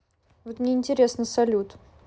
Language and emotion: Russian, neutral